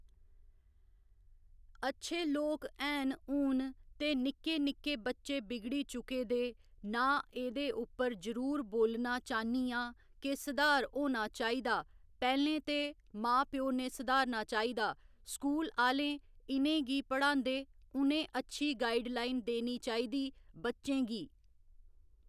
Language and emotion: Dogri, neutral